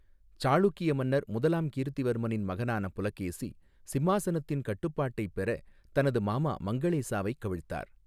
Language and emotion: Tamil, neutral